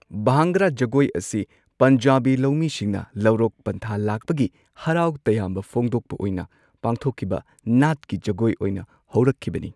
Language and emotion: Manipuri, neutral